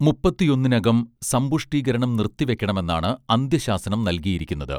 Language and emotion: Malayalam, neutral